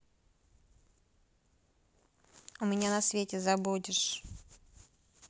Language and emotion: Russian, neutral